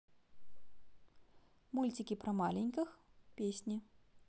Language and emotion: Russian, positive